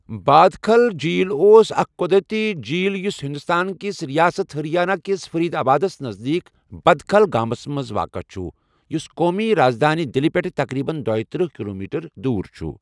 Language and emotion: Kashmiri, neutral